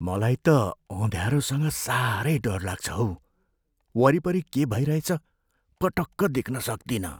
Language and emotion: Nepali, fearful